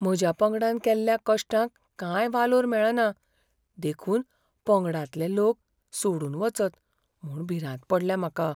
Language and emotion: Goan Konkani, fearful